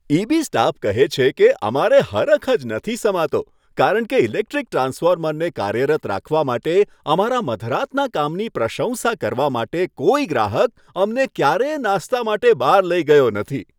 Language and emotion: Gujarati, happy